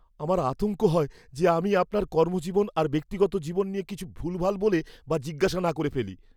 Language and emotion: Bengali, fearful